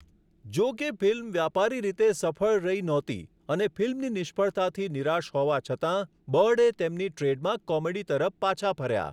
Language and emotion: Gujarati, neutral